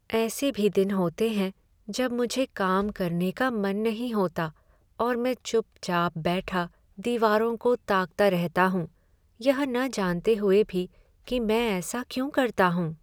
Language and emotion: Hindi, sad